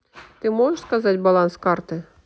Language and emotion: Russian, neutral